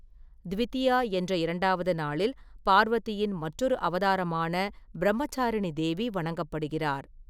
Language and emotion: Tamil, neutral